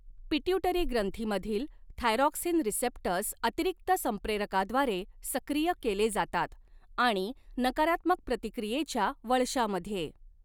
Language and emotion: Marathi, neutral